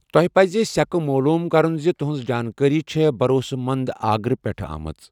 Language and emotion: Kashmiri, neutral